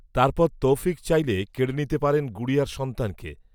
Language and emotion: Bengali, neutral